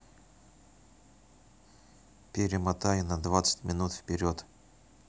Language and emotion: Russian, neutral